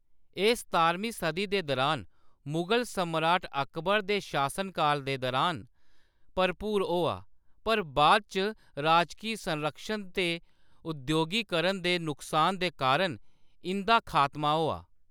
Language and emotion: Dogri, neutral